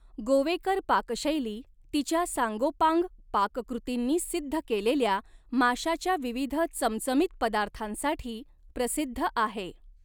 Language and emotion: Marathi, neutral